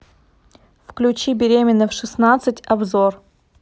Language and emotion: Russian, neutral